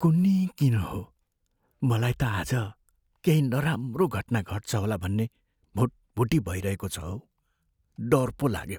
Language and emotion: Nepali, fearful